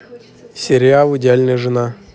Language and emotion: Russian, neutral